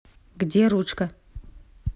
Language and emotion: Russian, neutral